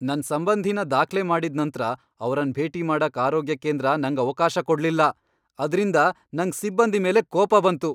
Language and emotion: Kannada, angry